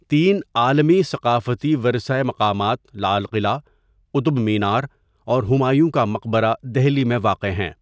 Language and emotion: Urdu, neutral